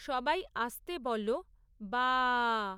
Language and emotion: Bengali, neutral